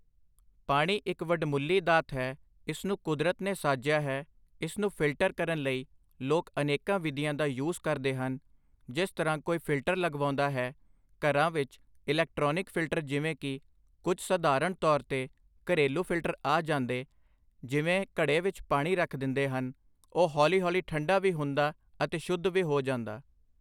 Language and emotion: Punjabi, neutral